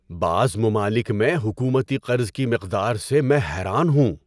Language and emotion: Urdu, surprised